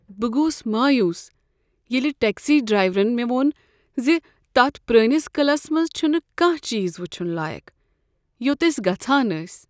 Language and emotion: Kashmiri, sad